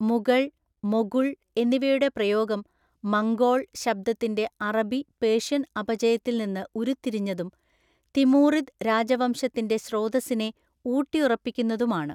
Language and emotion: Malayalam, neutral